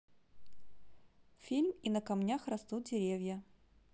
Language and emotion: Russian, positive